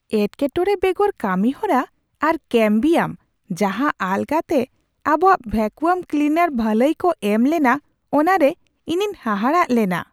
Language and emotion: Santali, surprised